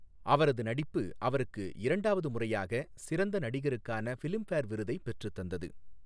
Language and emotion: Tamil, neutral